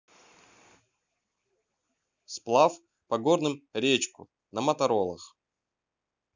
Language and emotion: Russian, neutral